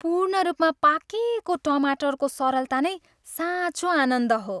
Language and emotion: Nepali, happy